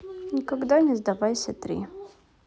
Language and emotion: Russian, neutral